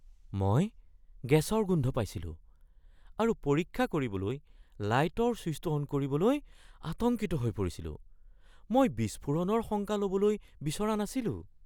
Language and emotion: Assamese, fearful